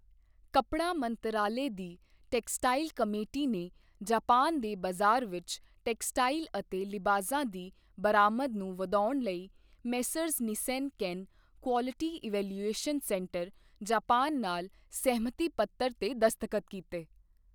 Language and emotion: Punjabi, neutral